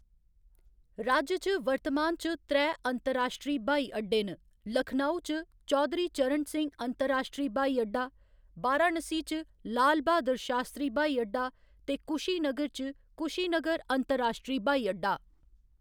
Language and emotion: Dogri, neutral